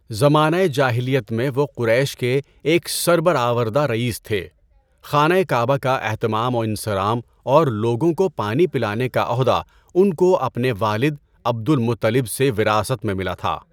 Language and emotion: Urdu, neutral